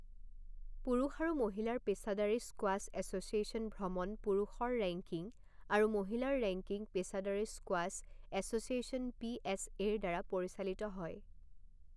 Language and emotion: Assamese, neutral